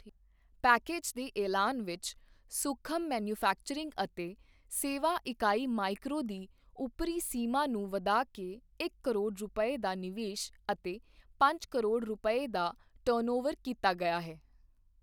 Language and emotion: Punjabi, neutral